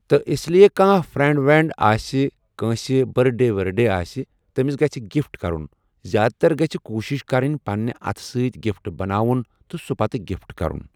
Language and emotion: Kashmiri, neutral